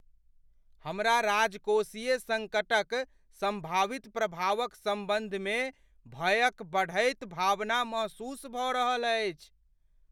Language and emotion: Maithili, fearful